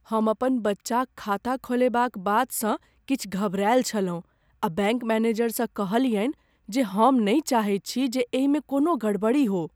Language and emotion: Maithili, fearful